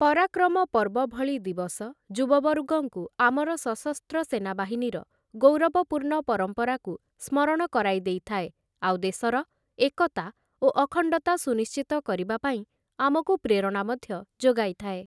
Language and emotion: Odia, neutral